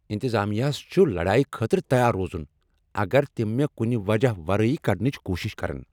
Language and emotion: Kashmiri, angry